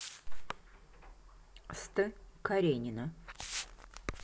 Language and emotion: Russian, neutral